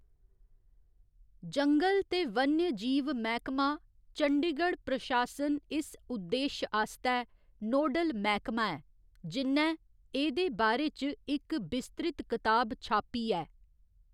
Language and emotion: Dogri, neutral